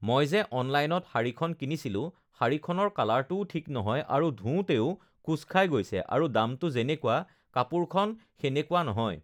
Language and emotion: Assamese, neutral